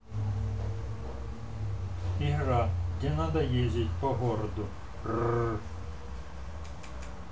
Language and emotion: Russian, neutral